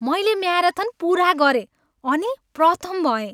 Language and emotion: Nepali, happy